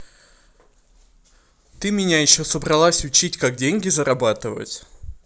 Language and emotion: Russian, angry